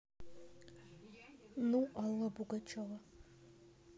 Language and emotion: Russian, neutral